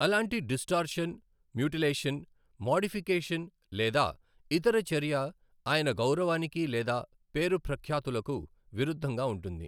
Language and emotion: Telugu, neutral